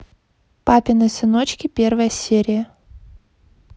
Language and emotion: Russian, neutral